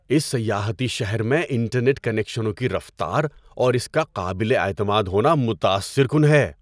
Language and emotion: Urdu, surprised